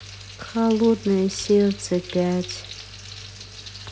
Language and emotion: Russian, sad